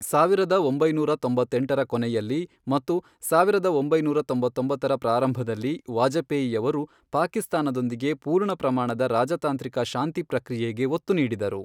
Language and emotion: Kannada, neutral